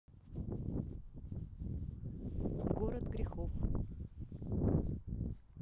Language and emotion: Russian, neutral